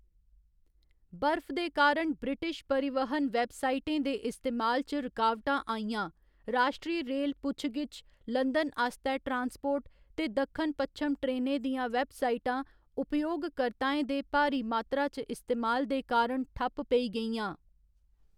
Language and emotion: Dogri, neutral